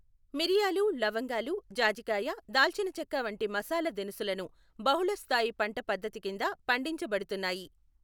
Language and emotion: Telugu, neutral